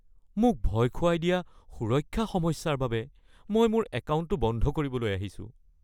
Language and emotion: Assamese, fearful